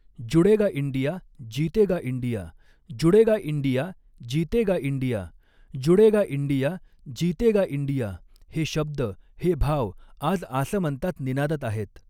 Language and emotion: Marathi, neutral